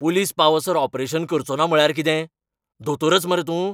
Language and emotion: Goan Konkani, angry